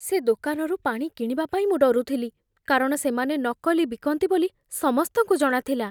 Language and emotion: Odia, fearful